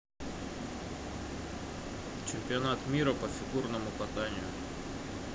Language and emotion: Russian, neutral